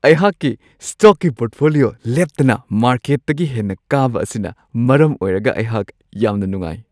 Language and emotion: Manipuri, happy